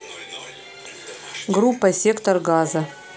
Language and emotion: Russian, neutral